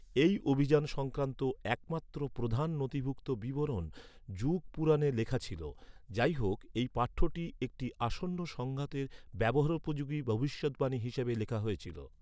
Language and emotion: Bengali, neutral